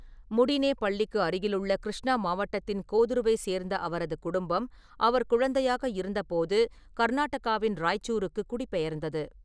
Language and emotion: Tamil, neutral